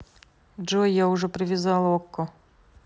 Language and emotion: Russian, neutral